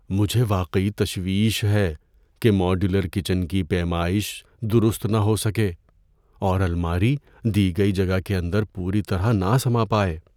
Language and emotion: Urdu, fearful